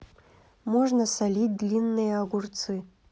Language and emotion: Russian, neutral